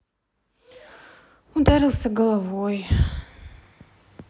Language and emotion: Russian, sad